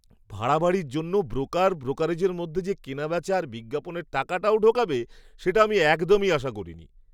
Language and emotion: Bengali, surprised